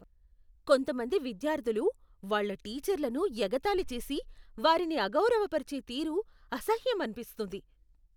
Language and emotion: Telugu, disgusted